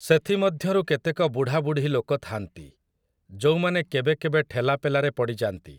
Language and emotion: Odia, neutral